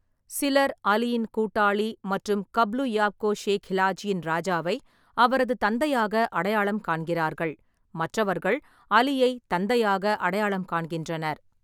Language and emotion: Tamil, neutral